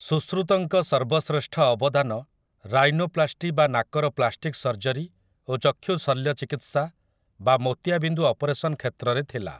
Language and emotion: Odia, neutral